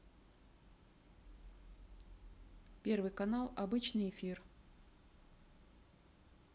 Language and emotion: Russian, neutral